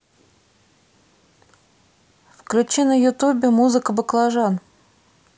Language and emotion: Russian, neutral